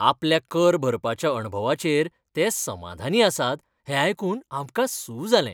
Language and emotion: Goan Konkani, happy